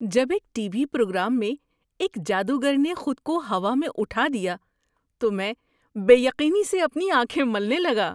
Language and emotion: Urdu, surprised